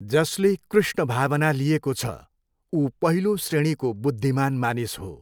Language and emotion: Nepali, neutral